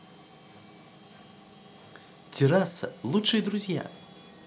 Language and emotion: Russian, positive